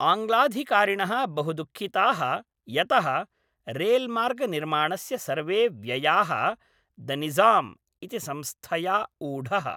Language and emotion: Sanskrit, neutral